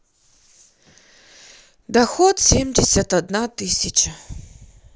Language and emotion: Russian, sad